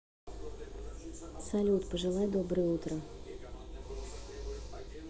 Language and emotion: Russian, neutral